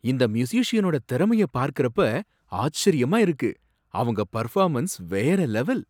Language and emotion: Tamil, surprised